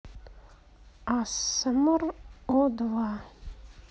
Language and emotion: Russian, neutral